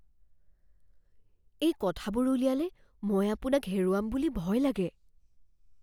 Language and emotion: Assamese, fearful